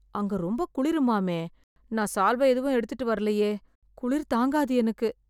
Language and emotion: Tamil, fearful